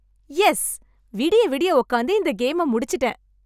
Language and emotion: Tamil, happy